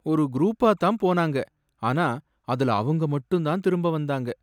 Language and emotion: Tamil, sad